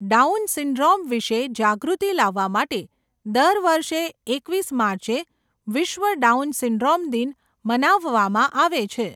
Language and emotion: Gujarati, neutral